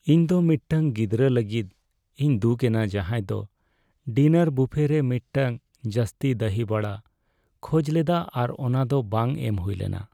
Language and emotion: Santali, sad